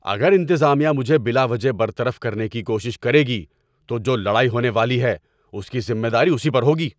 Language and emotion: Urdu, angry